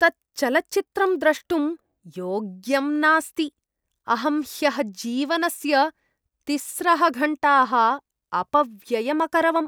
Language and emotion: Sanskrit, disgusted